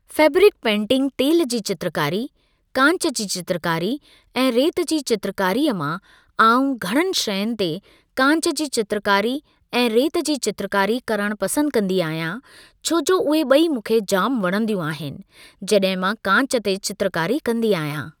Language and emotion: Sindhi, neutral